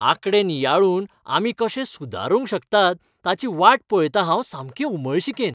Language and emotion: Goan Konkani, happy